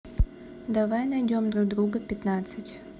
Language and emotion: Russian, neutral